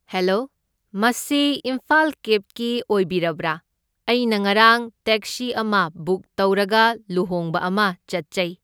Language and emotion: Manipuri, neutral